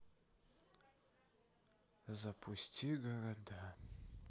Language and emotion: Russian, sad